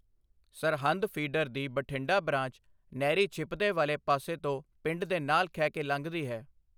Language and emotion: Punjabi, neutral